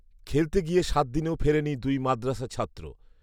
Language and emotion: Bengali, neutral